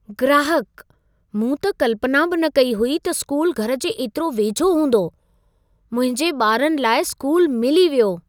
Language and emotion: Sindhi, surprised